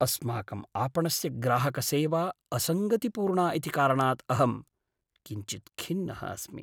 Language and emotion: Sanskrit, sad